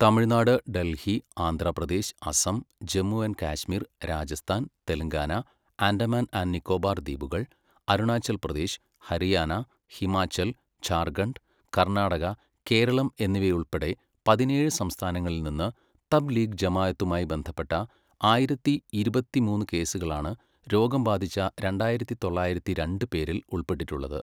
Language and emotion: Malayalam, neutral